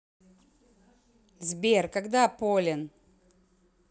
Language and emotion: Russian, angry